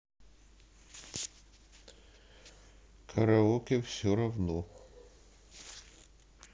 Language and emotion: Russian, neutral